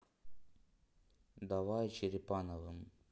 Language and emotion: Russian, neutral